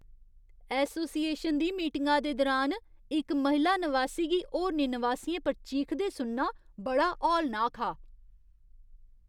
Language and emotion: Dogri, disgusted